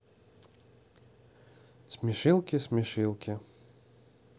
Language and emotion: Russian, neutral